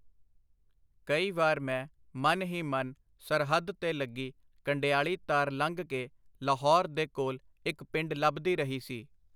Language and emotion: Punjabi, neutral